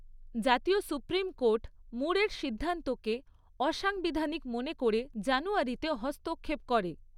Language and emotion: Bengali, neutral